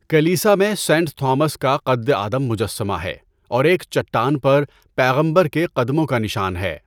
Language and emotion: Urdu, neutral